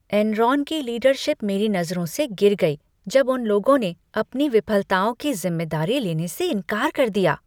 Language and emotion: Hindi, disgusted